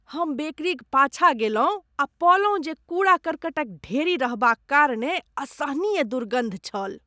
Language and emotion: Maithili, disgusted